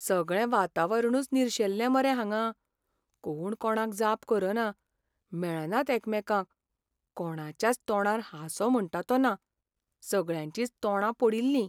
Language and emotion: Goan Konkani, sad